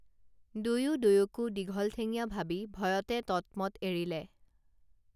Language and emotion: Assamese, neutral